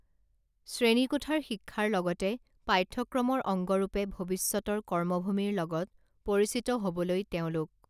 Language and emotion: Assamese, neutral